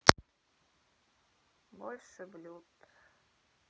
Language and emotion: Russian, sad